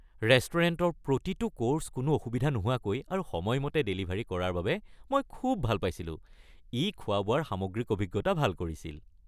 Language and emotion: Assamese, happy